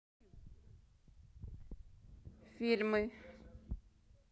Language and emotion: Russian, neutral